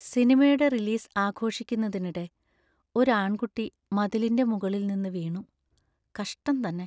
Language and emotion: Malayalam, sad